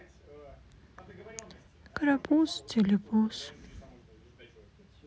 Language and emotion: Russian, sad